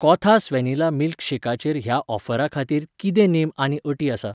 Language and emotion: Goan Konkani, neutral